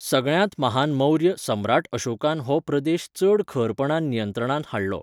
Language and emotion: Goan Konkani, neutral